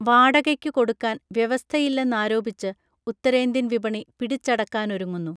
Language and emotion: Malayalam, neutral